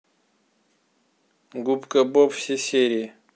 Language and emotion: Russian, neutral